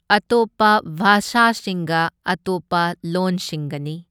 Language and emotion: Manipuri, neutral